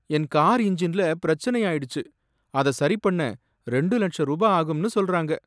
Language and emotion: Tamil, sad